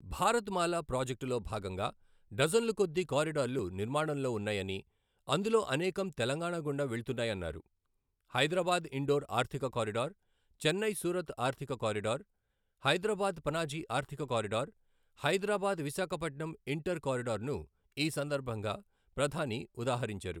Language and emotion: Telugu, neutral